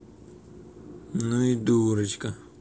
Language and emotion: Russian, angry